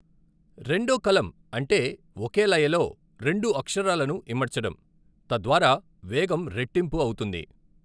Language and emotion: Telugu, neutral